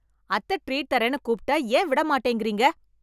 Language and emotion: Tamil, angry